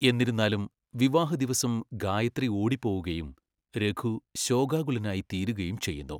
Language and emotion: Malayalam, neutral